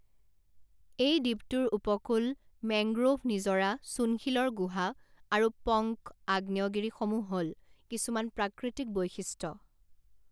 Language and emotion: Assamese, neutral